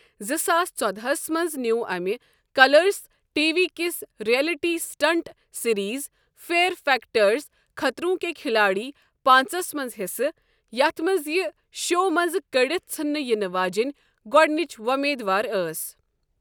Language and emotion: Kashmiri, neutral